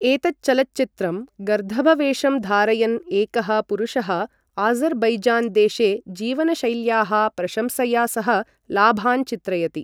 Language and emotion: Sanskrit, neutral